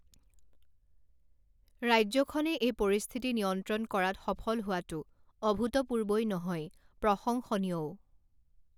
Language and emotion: Assamese, neutral